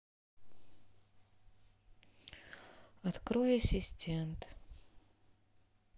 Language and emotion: Russian, sad